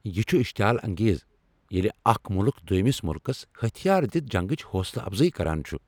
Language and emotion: Kashmiri, angry